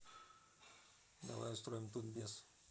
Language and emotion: Russian, neutral